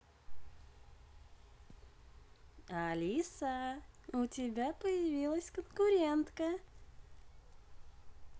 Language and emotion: Russian, positive